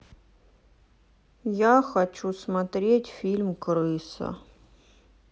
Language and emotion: Russian, sad